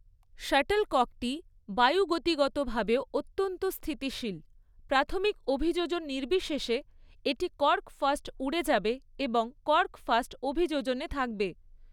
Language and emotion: Bengali, neutral